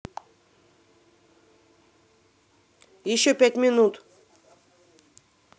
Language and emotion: Russian, angry